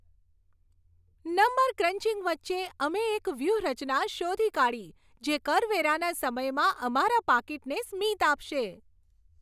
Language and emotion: Gujarati, happy